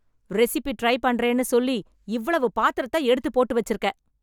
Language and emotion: Tamil, angry